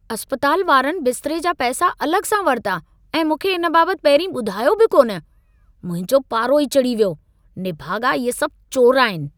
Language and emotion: Sindhi, angry